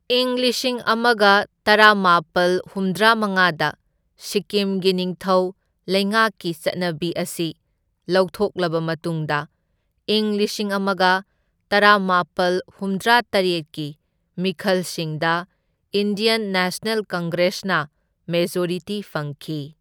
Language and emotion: Manipuri, neutral